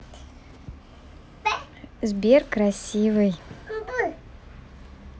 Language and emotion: Russian, positive